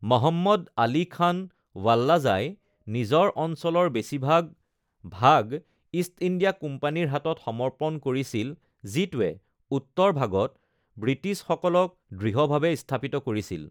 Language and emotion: Assamese, neutral